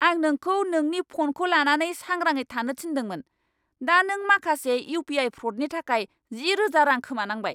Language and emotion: Bodo, angry